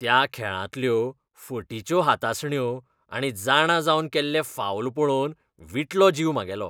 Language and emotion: Goan Konkani, disgusted